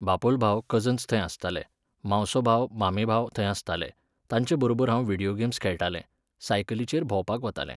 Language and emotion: Goan Konkani, neutral